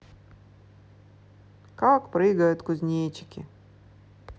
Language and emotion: Russian, neutral